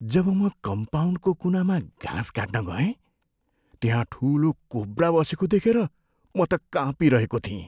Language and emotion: Nepali, fearful